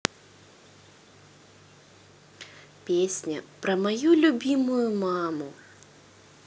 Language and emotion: Russian, positive